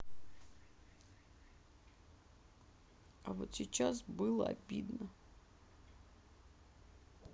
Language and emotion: Russian, sad